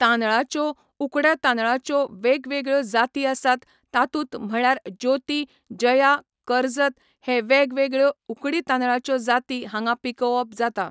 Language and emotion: Goan Konkani, neutral